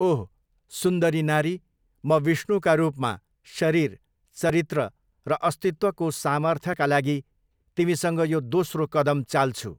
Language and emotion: Nepali, neutral